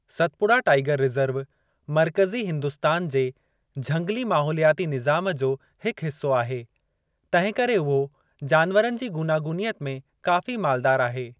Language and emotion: Sindhi, neutral